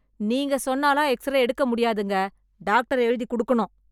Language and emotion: Tamil, angry